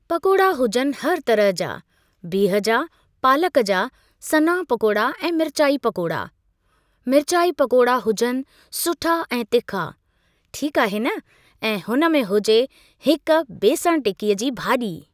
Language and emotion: Sindhi, neutral